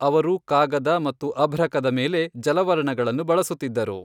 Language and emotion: Kannada, neutral